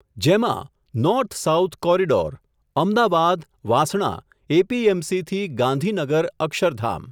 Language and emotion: Gujarati, neutral